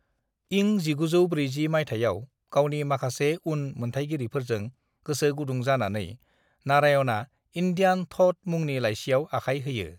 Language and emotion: Bodo, neutral